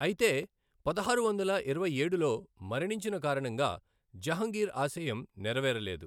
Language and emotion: Telugu, neutral